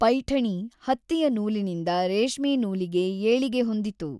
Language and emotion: Kannada, neutral